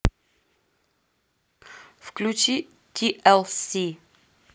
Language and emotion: Russian, neutral